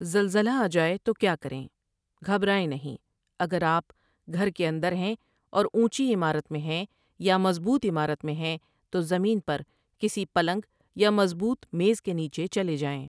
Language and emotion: Urdu, neutral